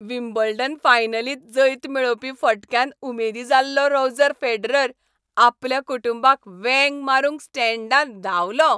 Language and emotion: Goan Konkani, happy